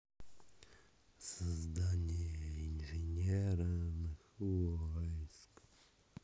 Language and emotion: Russian, neutral